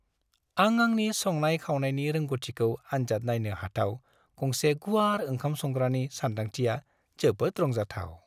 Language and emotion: Bodo, happy